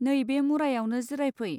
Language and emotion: Bodo, neutral